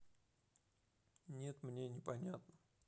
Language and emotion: Russian, neutral